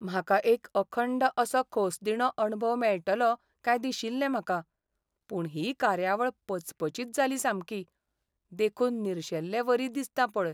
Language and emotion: Goan Konkani, sad